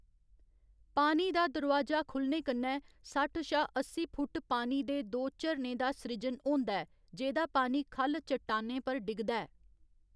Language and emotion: Dogri, neutral